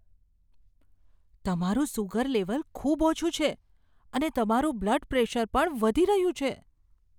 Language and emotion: Gujarati, fearful